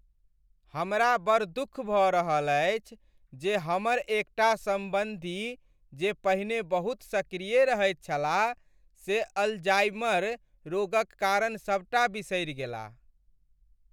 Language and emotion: Maithili, sad